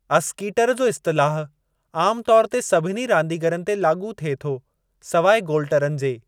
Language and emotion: Sindhi, neutral